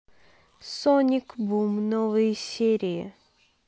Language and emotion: Russian, neutral